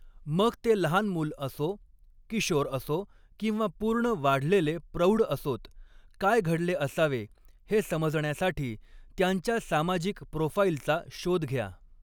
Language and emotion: Marathi, neutral